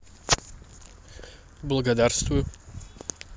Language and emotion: Russian, positive